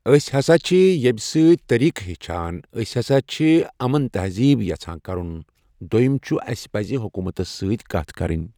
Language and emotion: Kashmiri, neutral